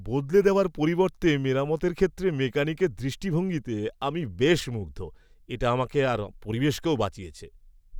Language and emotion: Bengali, happy